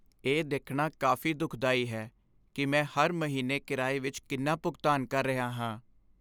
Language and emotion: Punjabi, sad